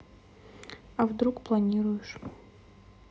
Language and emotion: Russian, neutral